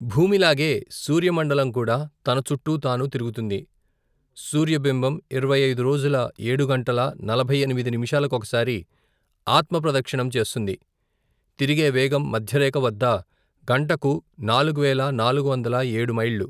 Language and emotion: Telugu, neutral